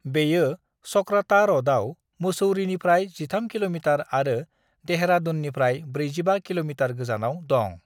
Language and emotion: Bodo, neutral